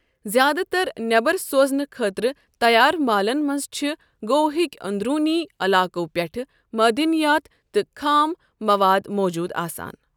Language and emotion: Kashmiri, neutral